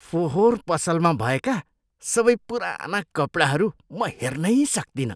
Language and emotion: Nepali, disgusted